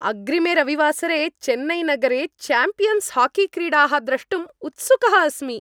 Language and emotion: Sanskrit, happy